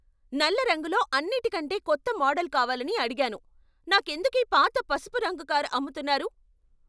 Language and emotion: Telugu, angry